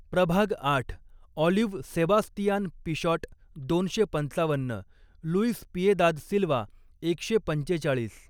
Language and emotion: Marathi, neutral